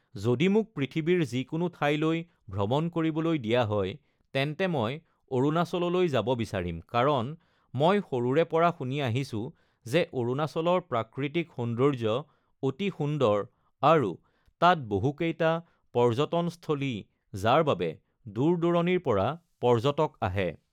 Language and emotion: Assamese, neutral